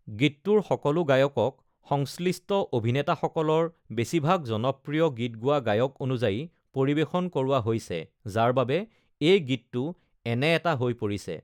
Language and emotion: Assamese, neutral